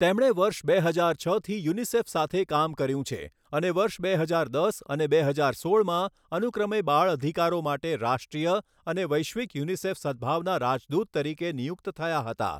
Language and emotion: Gujarati, neutral